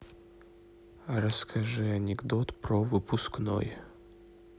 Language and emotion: Russian, neutral